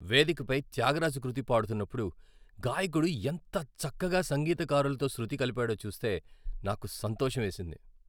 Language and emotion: Telugu, happy